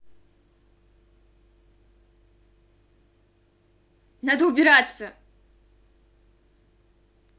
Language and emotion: Russian, angry